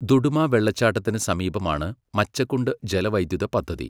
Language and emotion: Malayalam, neutral